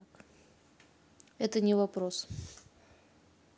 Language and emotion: Russian, neutral